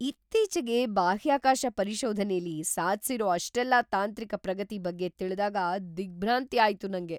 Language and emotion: Kannada, surprised